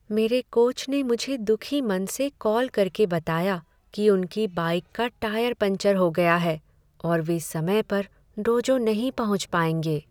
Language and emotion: Hindi, sad